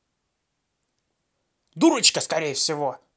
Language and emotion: Russian, angry